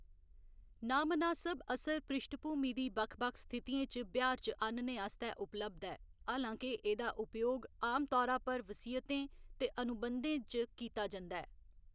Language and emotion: Dogri, neutral